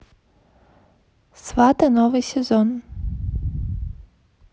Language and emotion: Russian, neutral